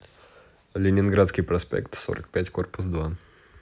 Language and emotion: Russian, neutral